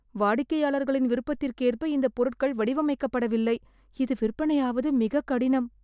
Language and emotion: Tamil, fearful